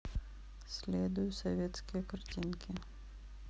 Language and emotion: Russian, neutral